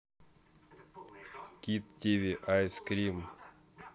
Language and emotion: Russian, neutral